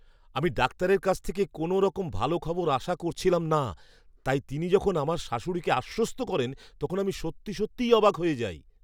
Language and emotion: Bengali, surprised